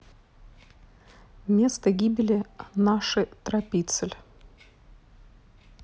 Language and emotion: Russian, neutral